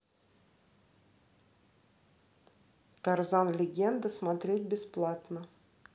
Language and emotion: Russian, neutral